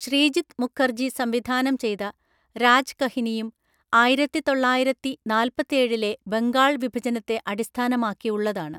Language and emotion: Malayalam, neutral